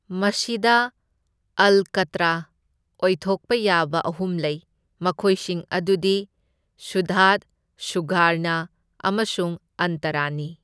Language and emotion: Manipuri, neutral